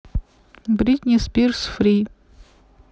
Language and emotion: Russian, neutral